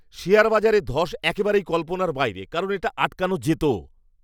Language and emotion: Bengali, angry